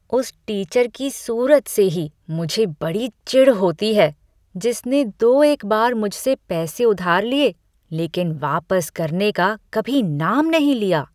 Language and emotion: Hindi, disgusted